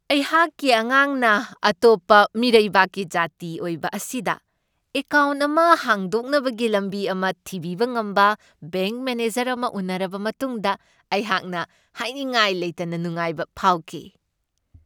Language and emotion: Manipuri, happy